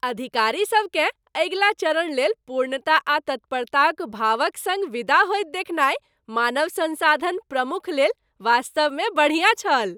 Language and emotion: Maithili, happy